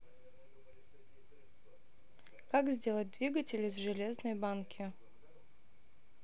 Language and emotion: Russian, neutral